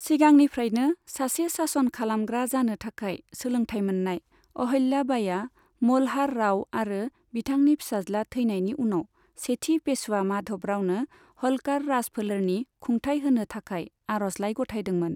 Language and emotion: Bodo, neutral